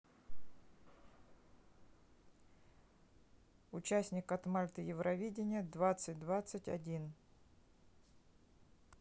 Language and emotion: Russian, neutral